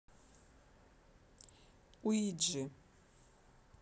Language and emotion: Russian, neutral